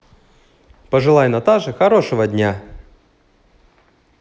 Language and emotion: Russian, positive